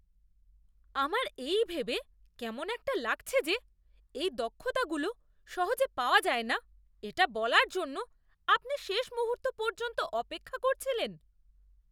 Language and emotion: Bengali, disgusted